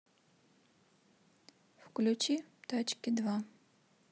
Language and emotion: Russian, neutral